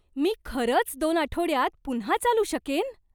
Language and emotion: Marathi, surprised